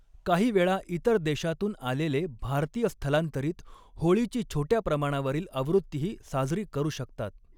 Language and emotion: Marathi, neutral